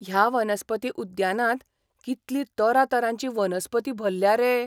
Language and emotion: Goan Konkani, surprised